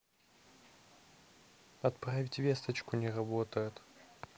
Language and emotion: Russian, neutral